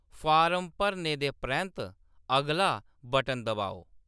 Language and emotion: Dogri, neutral